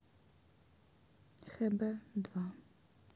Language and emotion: Russian, sad